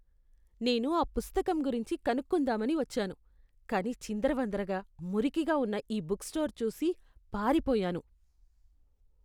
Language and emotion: Telugu, disgusted